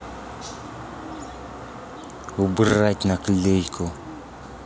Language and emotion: Russian, angry